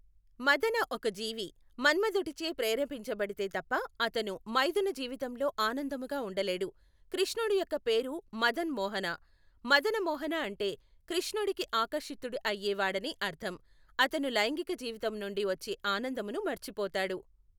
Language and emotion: Telugu, neutral